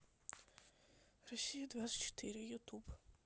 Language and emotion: Russian, neutral